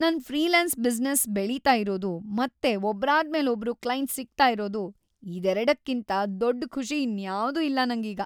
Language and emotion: Kannada, happy